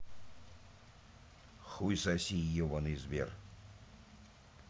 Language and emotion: Russian, angry